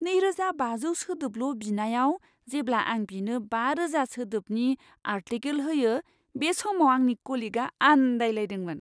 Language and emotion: Bodo, surprised